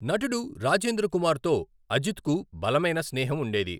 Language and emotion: Telugu, neutral